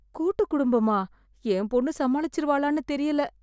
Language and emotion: Tamil, fearful